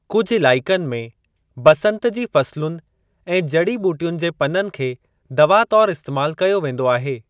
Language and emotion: Sindhi, neutral